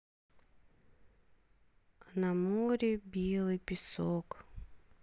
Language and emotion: Russian, sad